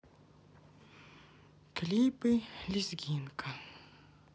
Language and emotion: Russian, sad